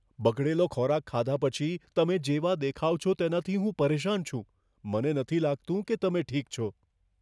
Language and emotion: Gujarati, fearful